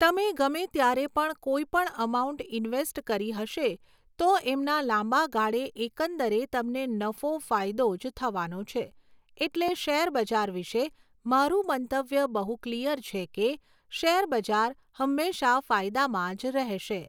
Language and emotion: Gujarati, neutral